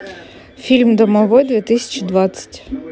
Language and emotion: Russian, neutral